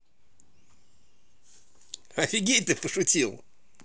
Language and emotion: Russian, positive